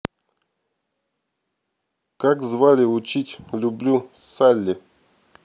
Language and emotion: Russian, neutral